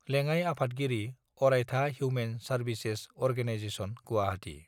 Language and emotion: Bodo, neutral